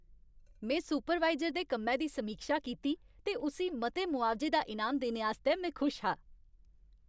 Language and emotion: Dogri, happy